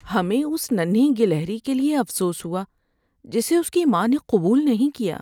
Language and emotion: Urdu, sad